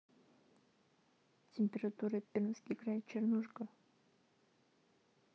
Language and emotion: Russian, neutral